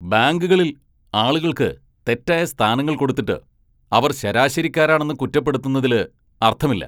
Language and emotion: Malayalam, angry